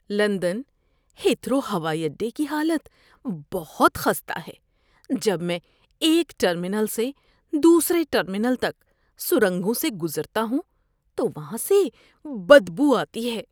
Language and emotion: Urdu, disgusted